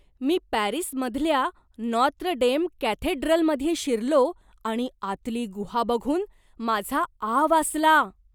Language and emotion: Marathi, surprised